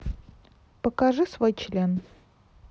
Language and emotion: Russian, neutral